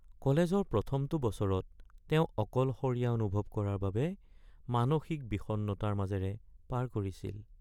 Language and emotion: Assamese, sad